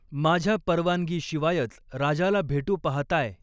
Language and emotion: Marathi, neutral